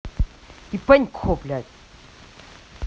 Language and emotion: Russian, angry